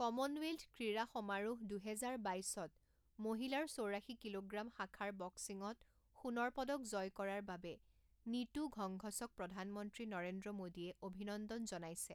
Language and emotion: Assamese, neutral